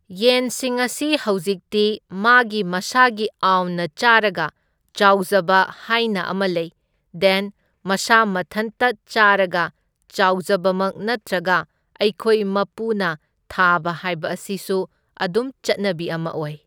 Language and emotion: Manipuri, neutral